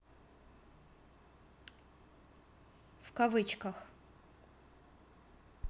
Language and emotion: Russian, neutral